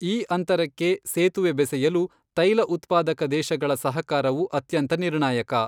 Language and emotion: Kannada, neutral